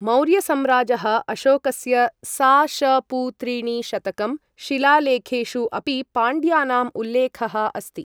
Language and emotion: Sanskrit, neutral